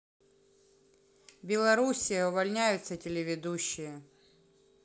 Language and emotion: Russian, neutral